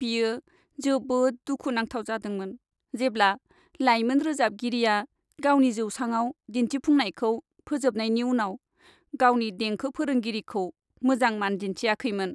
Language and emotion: Bodo, sad